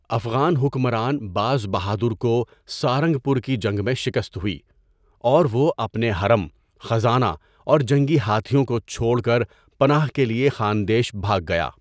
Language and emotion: Urdu, neutral